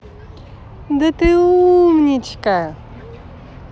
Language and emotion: Russian, positive